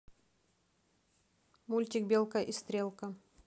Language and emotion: Russian, neutral